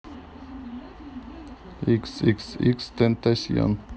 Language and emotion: Russian, neutral